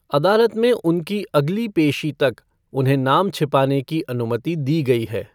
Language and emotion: Hindi, neutral